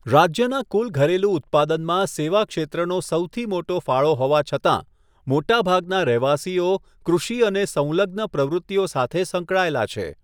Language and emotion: Gujarati, neutral